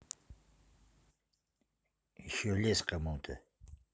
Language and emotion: Russian, neutral